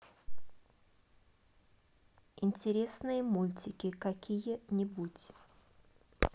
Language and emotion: Russian, neutral